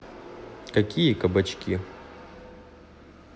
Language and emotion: Russian, neutral